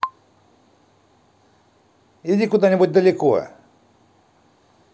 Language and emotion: Russian, angry